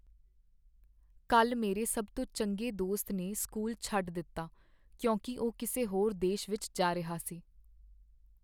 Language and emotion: Punjabi, sad